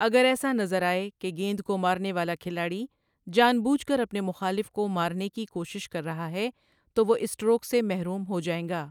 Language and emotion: Urdu, neutral